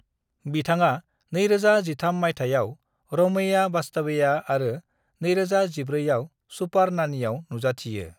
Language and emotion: Bodo, neutral